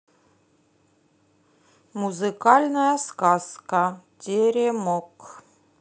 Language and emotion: Russian, neutral